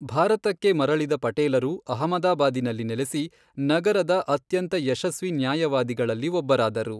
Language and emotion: Kannada, neutral